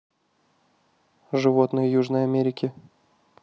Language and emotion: Russian, neutral